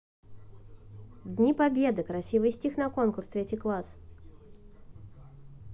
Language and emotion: Russian, neutral